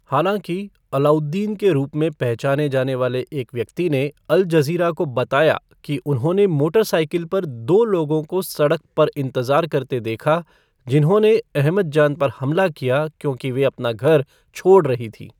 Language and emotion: Hindi, neutral